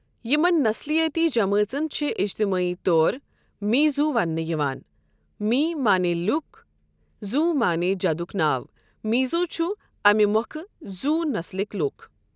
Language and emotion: Kashmiri, neutral